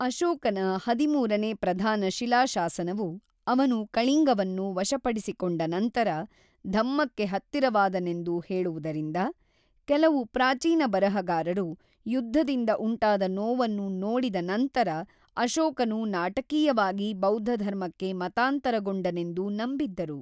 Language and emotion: Kannada, neutral